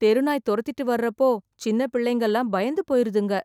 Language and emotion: Tamil, fearful